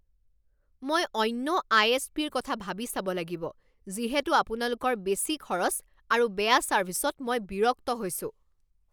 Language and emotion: Assamese, angry